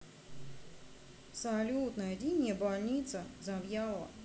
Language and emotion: Russian, neutral